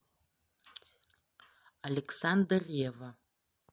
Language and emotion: Russian, neutral